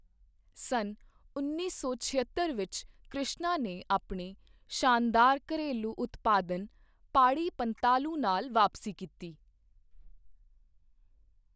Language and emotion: Punjabi, neutral